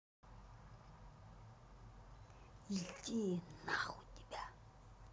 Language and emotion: Russian, angry